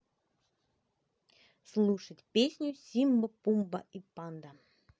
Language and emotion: Russian, positive